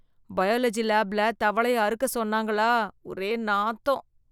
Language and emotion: Tamil, disgusted